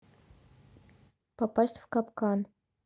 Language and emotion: Russian, neutral